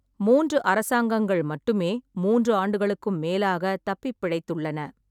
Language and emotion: Tamil, neutral